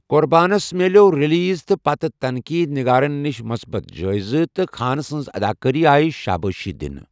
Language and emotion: Kashmiri, neutral